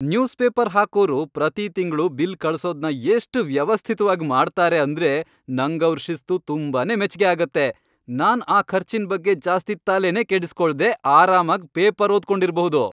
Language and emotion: Kannada, happy